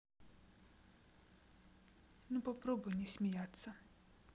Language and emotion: Russian, neutral